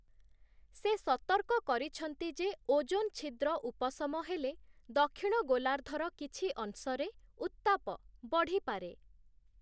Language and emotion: Odia, neutral